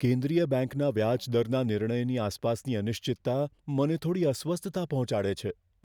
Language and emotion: Gujarati, fearful